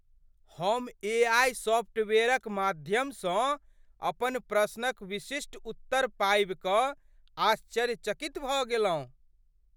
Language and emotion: Maithili, surprised